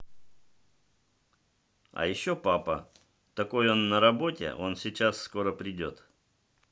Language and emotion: Russian, neutral